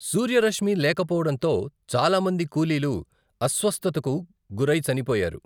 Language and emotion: Telugu, neutral